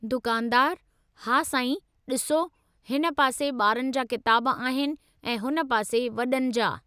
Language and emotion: Sindhi, neutral